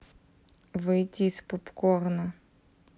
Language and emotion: Russian, neutral